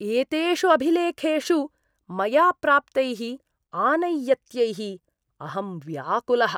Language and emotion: Sanskrit, disgusted